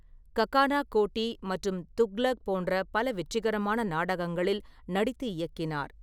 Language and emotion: Tamil, neutral